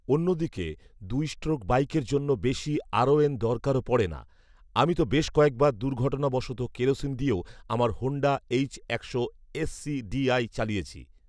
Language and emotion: Bengali, neutral